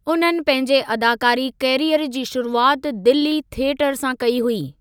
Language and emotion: Sindhi, neutral